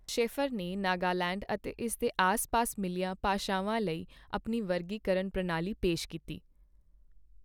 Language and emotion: Punjabi, neutral